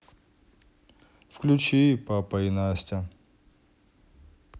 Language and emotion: Russian, neutral